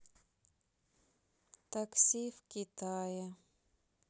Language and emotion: Russian, sad